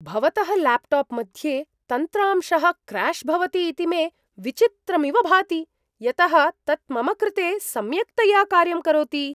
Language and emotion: Sanskrit, surprised